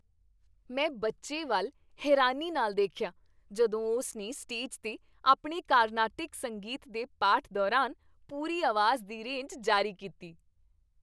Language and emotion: Punjabi, happy